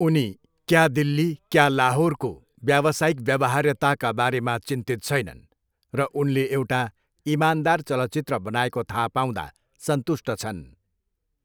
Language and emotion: Nepali, neutral